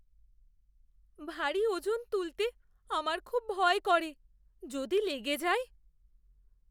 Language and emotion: Bengali, fearful